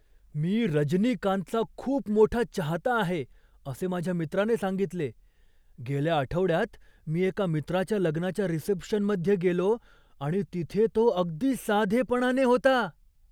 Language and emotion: Marathi, surprised